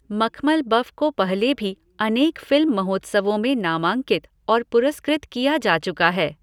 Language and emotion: Hindi, neutral